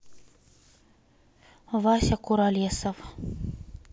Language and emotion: Russian, neutral